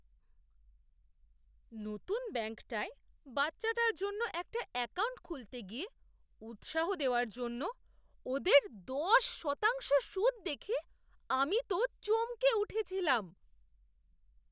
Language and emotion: Bengali, surprised